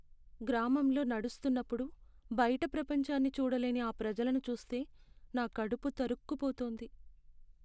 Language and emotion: Telugu, sad